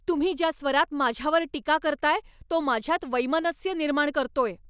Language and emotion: Marathi, angry